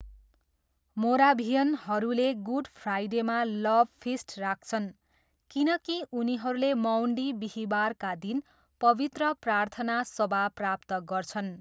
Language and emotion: Nepali, neutral